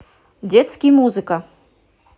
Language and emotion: Russian, positive